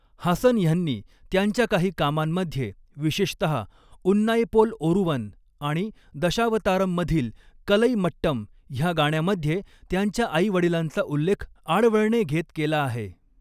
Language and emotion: Marathi, neutral